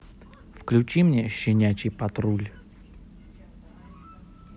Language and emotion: Russian, neutral